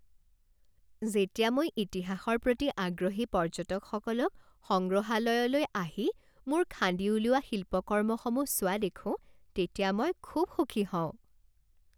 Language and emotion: Assamese, happy